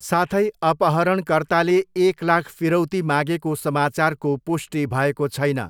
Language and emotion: Nepali, neutral